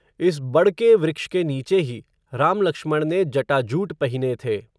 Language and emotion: Hindi, neutral